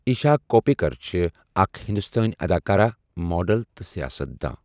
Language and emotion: Kashmiri, neutral